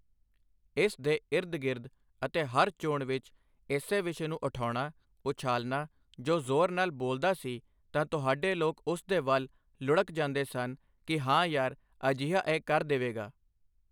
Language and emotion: Punjabi, neutral